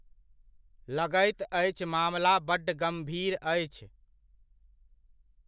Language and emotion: Maithili, neutral